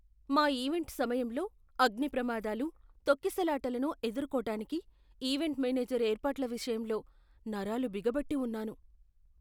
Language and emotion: Telugu, fearful